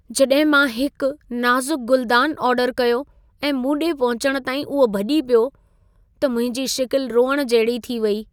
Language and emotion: Sindhi, sad